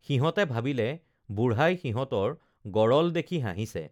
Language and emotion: Assamese, neutral